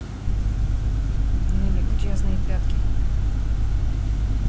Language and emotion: Russian, neutral